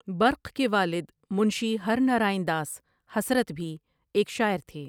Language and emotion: Urdu, neutral